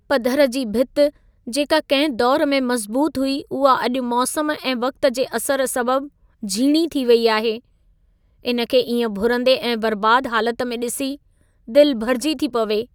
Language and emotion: Sindhi, sad